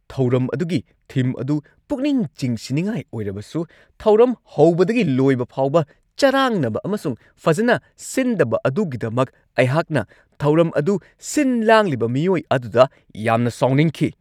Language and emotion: Manipuri, angry